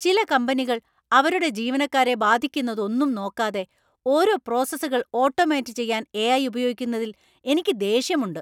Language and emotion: Malayalam, angry